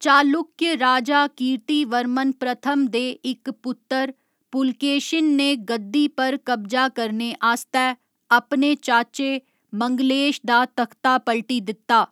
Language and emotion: Dogri, neutral